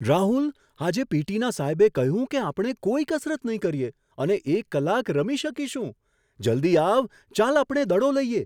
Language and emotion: Gujarati, surprised